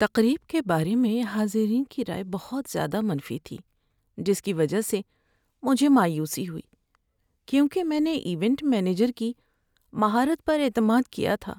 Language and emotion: Urdu, sad